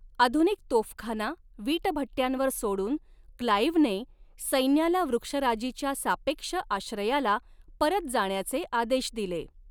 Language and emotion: Marathi, neutral